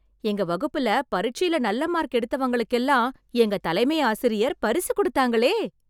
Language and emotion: Tamil, happy